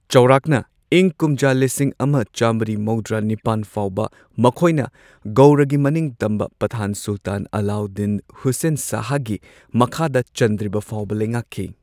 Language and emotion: Manipuri, neutral